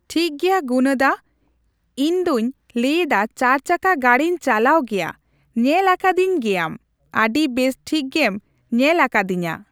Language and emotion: Santali, neutral